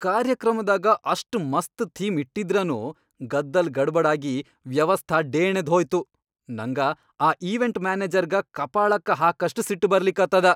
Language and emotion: Kannada, angry